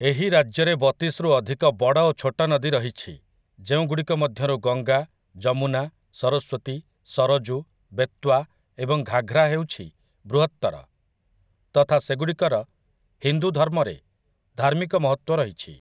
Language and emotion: Odia, neutral